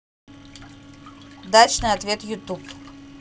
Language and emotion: Russian, neutral